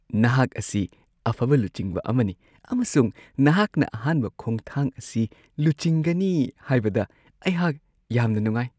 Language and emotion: Manipuri, happy